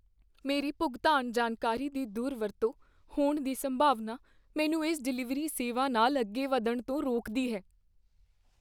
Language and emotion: Punjabi, fearful